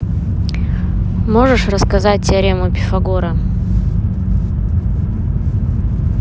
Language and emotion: Russian, neutral